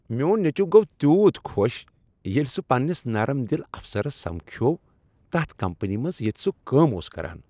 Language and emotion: Kashmiri, happy